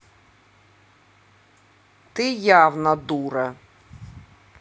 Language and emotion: Russian, angry